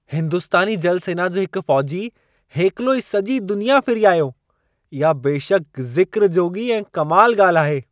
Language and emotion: Sindhi, surprised